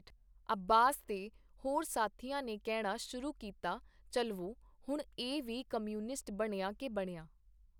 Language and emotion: Punjabi, neutral